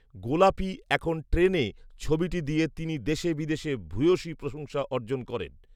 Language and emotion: Bengali, neutral